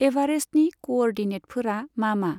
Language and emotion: Bodo, neutral